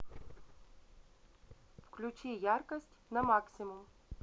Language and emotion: Russian, neutral